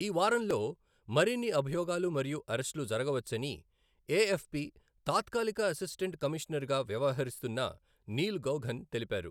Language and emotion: Telugu, neutral